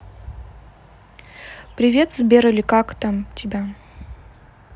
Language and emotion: Russian, neutral